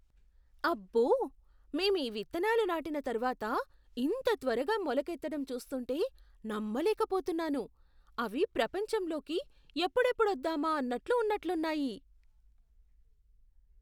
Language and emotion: Telugu, surprised